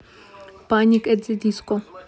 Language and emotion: Russian, neutral